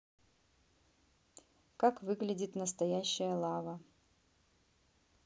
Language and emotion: Russian, neutral